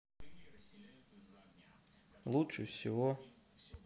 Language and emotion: Russian, sad